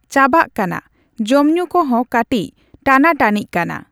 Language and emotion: Santali, neutral